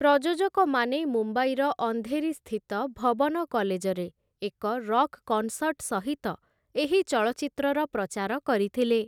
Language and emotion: Odia, neutral